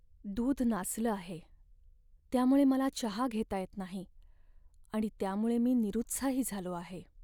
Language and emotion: Marathi, sad